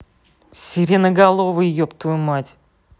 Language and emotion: Russian, angry